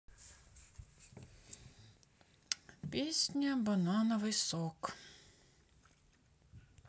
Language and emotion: Russian, sad